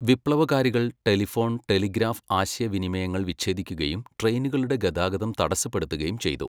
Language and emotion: Malayalam, neutral